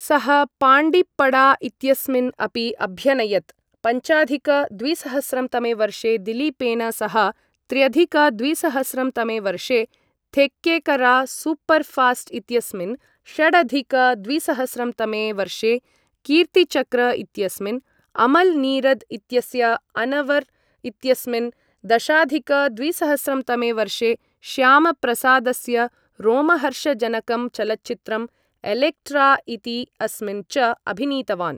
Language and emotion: Sanskrit, neutral